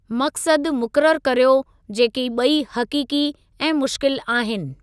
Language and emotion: Sindhi, neutral